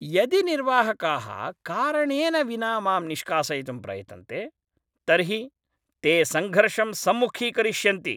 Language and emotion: Sanskrit, angry